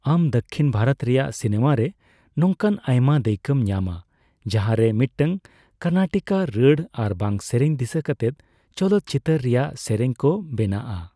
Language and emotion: Santali, neutral